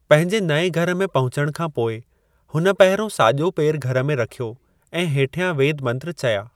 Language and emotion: Sindhi, neutral